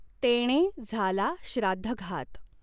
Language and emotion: Marathi, neutral